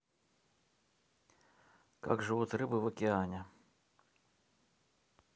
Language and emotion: Russian, neutral